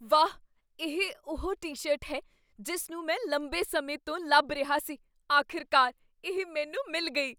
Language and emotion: Punjabi, surprised